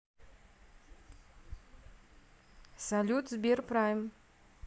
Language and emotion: Russian, neutral